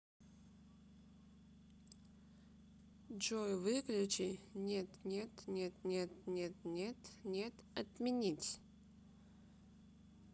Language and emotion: Russian, neutral